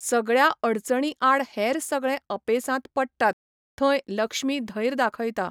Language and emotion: Goan Konkani, neutral